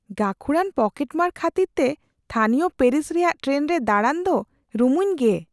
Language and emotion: Santali, fearful